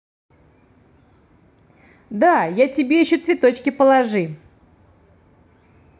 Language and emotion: Russian, positive